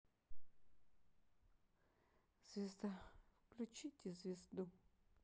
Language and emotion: Russian, sad